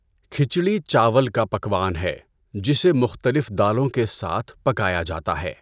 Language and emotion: Urdu, neutral